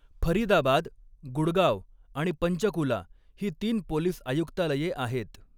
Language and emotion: Marathi, neutral